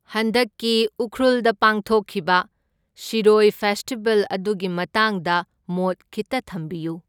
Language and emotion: Manipuri, neutral